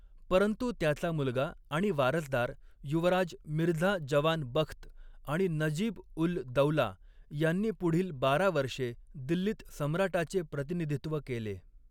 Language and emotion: Marathi, neutral